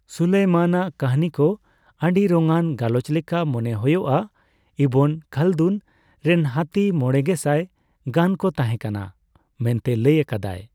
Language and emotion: Santali, neutral